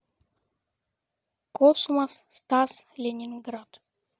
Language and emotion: Russian, neutral